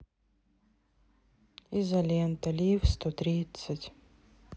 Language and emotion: Russian, sad